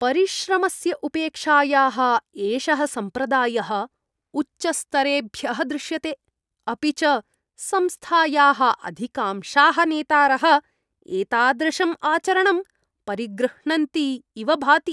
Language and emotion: Sanskrit, disgusted